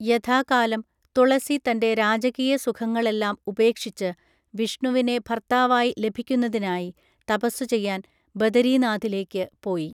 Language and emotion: Malayalam, neutral